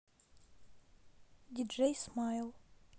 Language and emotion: Russian, neutral